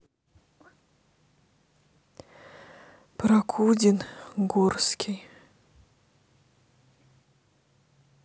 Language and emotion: Russian, sad